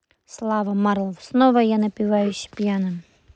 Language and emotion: Russian, neutral